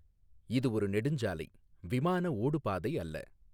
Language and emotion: Tamil, neutral